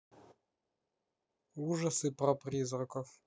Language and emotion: Russian, neutral